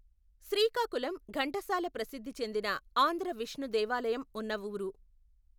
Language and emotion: Telugu, neutral